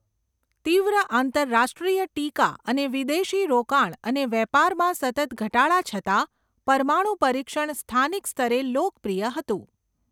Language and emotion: Gujarati, neutral